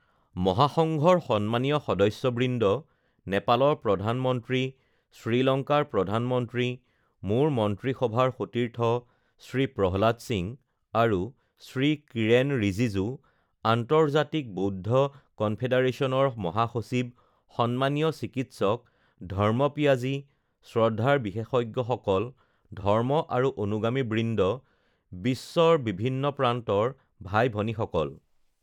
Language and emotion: Assamese, neutral